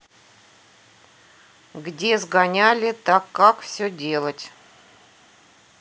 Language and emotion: Russian, neutral